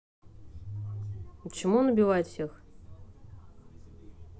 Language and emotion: Russian, neutral